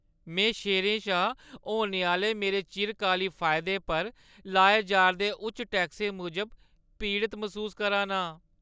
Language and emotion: Dogri, sad